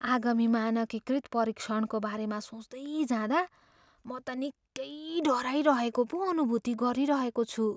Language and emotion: Nepali, fearful